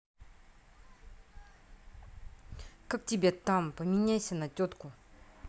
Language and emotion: Russian, angry